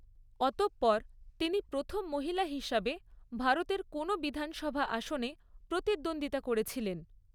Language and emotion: Bengali, neutral